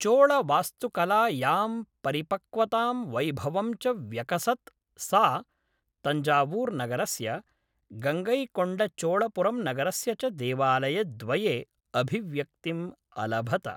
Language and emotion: Sanskrit, neutral